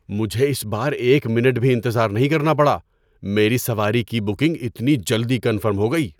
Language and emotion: Urdu, surprised